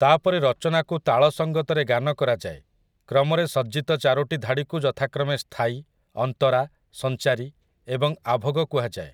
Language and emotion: Odia, neutral